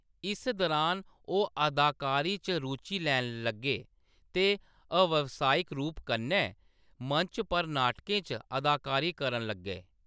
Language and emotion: Dogri, neutral